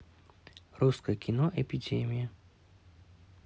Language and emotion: Russian, neutral